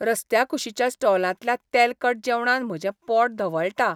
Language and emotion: Goan Konkani, disgusted